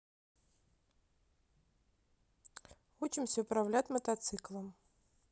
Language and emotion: Russian, neutral